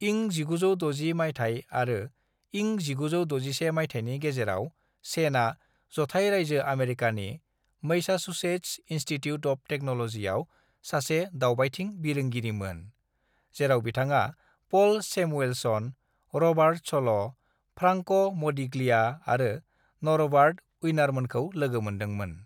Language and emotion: Bodo, neutral